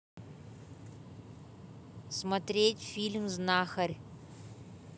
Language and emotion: Russian, neutral